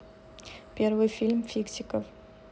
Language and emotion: Russian, neutral